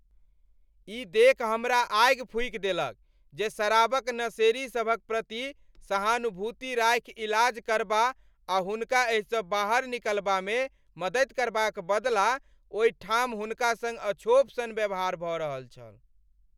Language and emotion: Maithili, angry